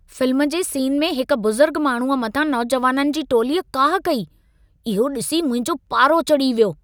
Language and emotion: Sindhi, angry